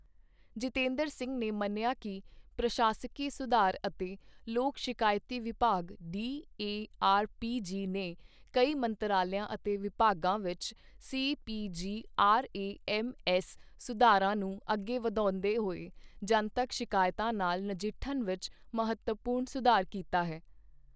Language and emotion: Punjabi, neutral